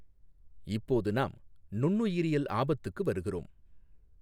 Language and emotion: Tamil, neutral